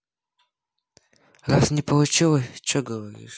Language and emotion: Russian, neutral